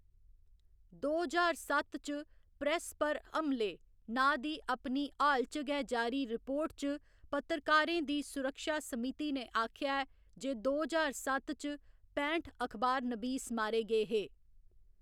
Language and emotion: Dogri, neutral